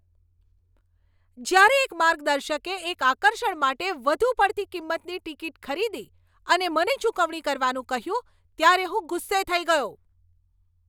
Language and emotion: Gujarati, angry